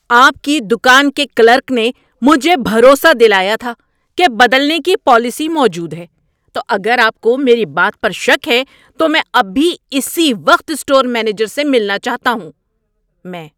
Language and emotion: Urdu, angry